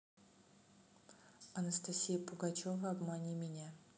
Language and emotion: Russian, neutral